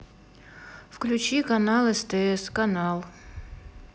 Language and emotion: Russian, neutral